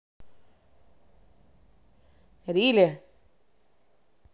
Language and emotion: Russian, neutral